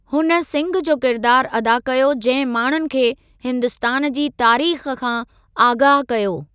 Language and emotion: Sindhi, neutral